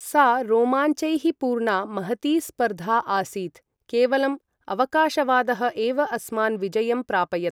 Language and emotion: Sanskrit, neutral